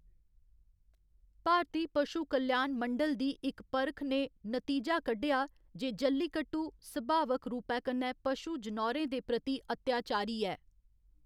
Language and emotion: Dogri, neutral